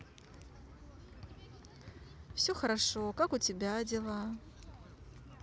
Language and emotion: Russian, positive